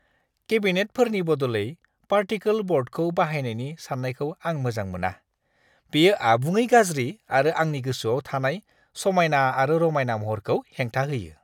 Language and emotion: Bodo, disgusted